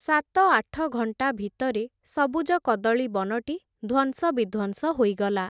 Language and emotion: Odia, neutral